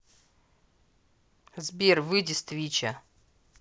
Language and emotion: Russian, neutral